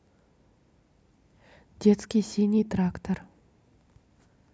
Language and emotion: Russian, neutral